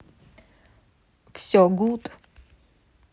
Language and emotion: Russian, neutral